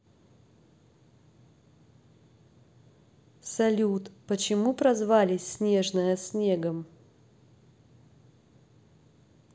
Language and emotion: Russian, neutral